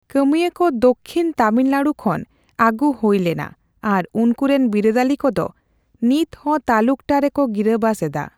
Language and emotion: Santali, neutral